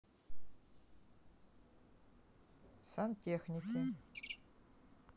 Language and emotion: Russian, neutral